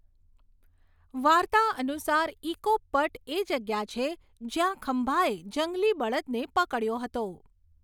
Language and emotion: Gujarati, neutral